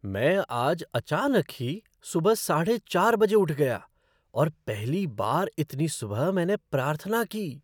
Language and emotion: Hindi, surprised